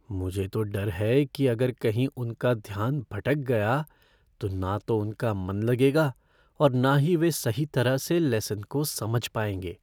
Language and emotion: Hindi, fearful